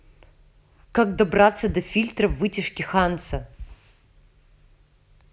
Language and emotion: Russian, angry